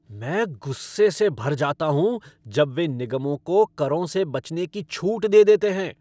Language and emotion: Hindi, angry